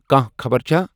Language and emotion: Kashmiri, neutral